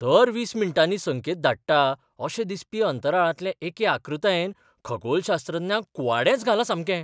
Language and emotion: Goan Konkani, surprised